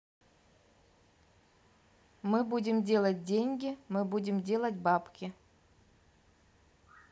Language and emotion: Russian, neutral